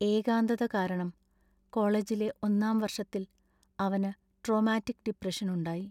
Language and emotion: Malayalam, sad